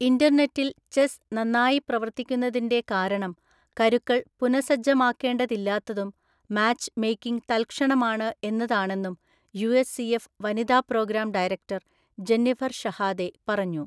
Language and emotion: Malayalam, neutral